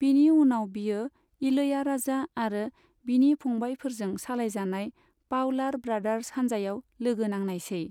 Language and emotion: Bodo, neutral